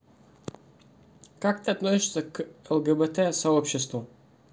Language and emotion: Russian, neutral